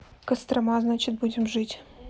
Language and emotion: Russian, neutral